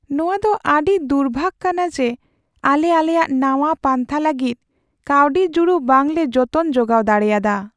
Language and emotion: Santali, sad